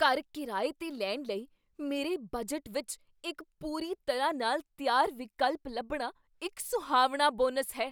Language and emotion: Punjabi, surprised